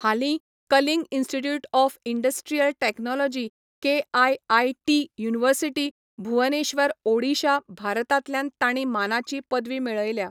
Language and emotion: Goan Konkani, neutral